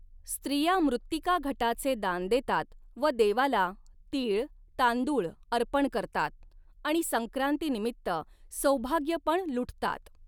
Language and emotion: Marathi, neutral